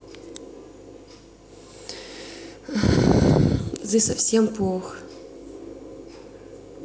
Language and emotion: Russian, sad